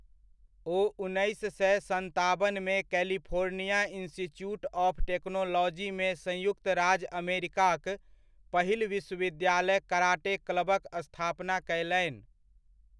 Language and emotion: Maithili, neutral